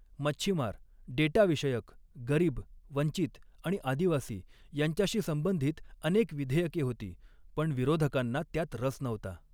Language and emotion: Marathi, neutral